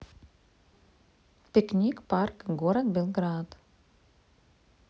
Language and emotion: Russian, neutral